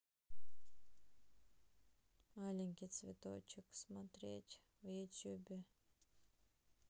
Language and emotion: Russian, sad